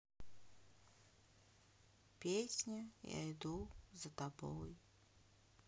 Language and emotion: Russian, sad